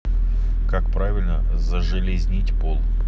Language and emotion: Russian, neutral